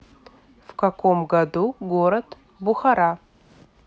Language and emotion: Russian, neutral